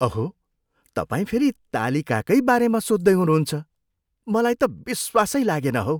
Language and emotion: Nepali, disgusted